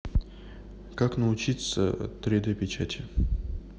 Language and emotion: Russian, neutral